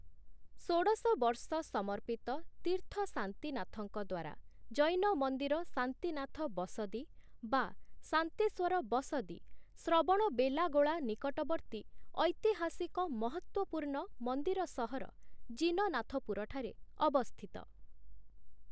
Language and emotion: Odia, neutral